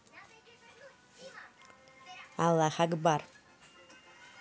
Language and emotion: Russian, positive